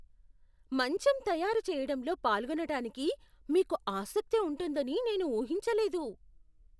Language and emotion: Telugu, surprised